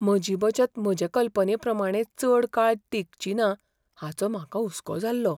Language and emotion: Goan Konkani, fearful